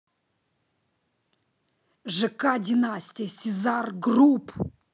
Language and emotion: Russian, angry